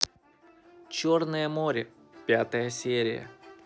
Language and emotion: Russian, neutral